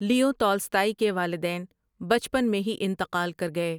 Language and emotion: Urdu, neutral